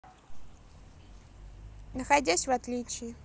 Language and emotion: Russian, neutral